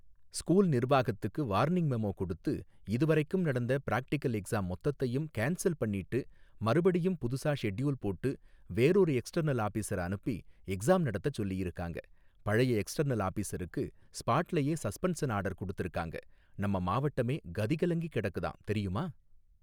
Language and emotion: Tamil, neutral